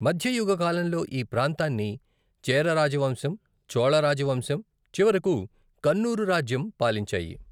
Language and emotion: Telugu, neutral